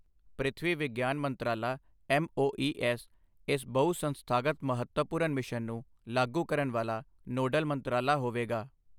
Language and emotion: Punjabi, neutral